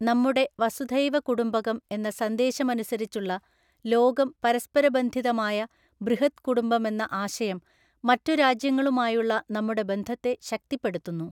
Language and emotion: Malayalam, neutral